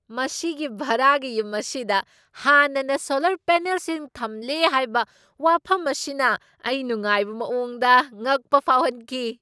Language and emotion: Manipuri, surprised